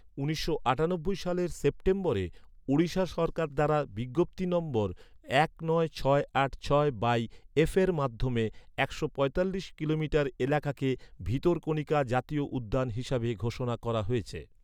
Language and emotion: Bengali, neutral